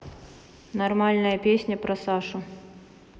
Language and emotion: Russian, neutral